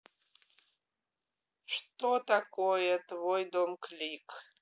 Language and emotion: Russian, neutral